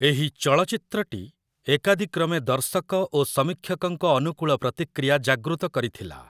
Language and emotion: Odia, neutral